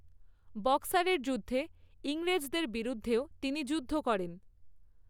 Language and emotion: Bengali, neutral